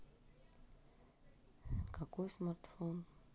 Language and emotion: Russian, neutral